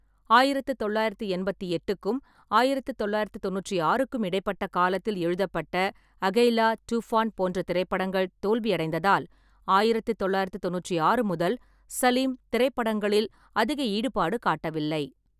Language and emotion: Tamil, neutral